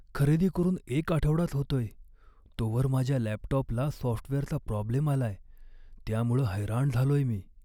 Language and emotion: Marathi, sad